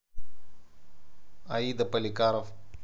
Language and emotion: Russian, neutral